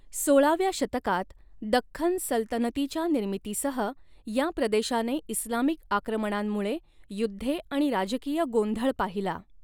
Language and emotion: Marathi, neutral